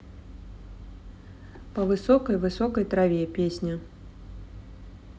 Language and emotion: Russian, neutral